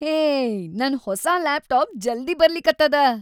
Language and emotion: Kannada, happy